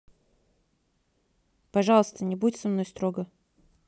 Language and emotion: Russian, neutral